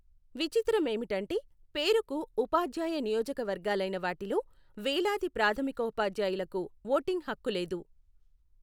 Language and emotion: Telugu, neutral